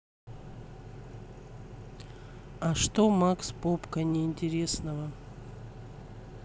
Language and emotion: Russian, neutral